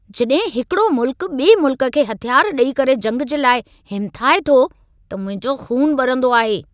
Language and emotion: Sindhi, angry